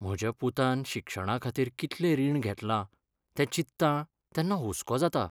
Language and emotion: Goan Konkani, sad